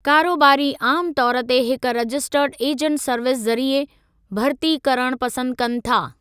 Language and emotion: Sindhi, neutral